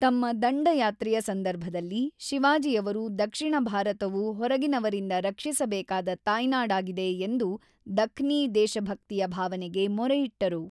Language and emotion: Kannada, neutral